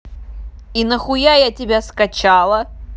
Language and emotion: Russian, angry